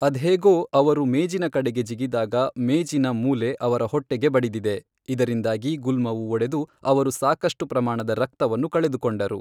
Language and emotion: Kannada, neutral